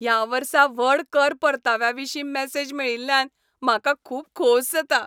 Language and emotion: Goan Konkani, happy